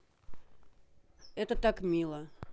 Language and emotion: Russian, neutral